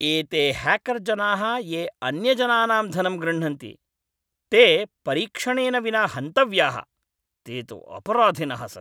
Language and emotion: Sanskrit, angry